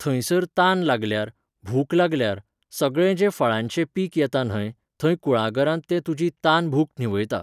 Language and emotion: Goan Konkani, neutral